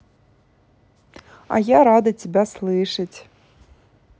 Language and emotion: Russian, positive